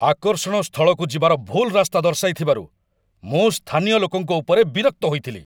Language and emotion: Odia, angry